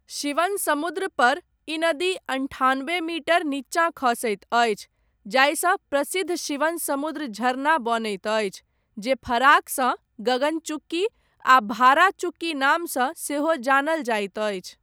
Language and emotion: Maithili, neutral